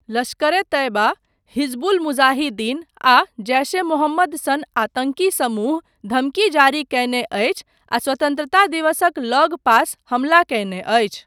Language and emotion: Maithili, neutral